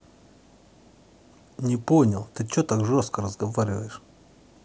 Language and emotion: Russian, angry